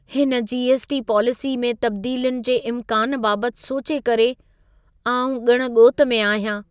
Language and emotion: Sindhi, fearful